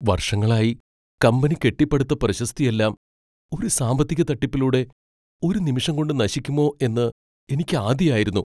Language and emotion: Malayalam, fearful